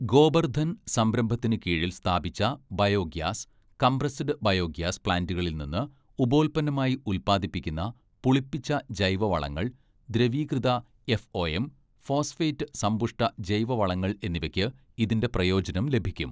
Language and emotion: Malayalam, neutral